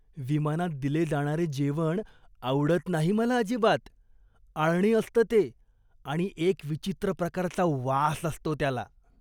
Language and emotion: Marathi, disgusted